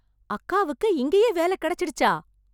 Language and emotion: Tamil, surprised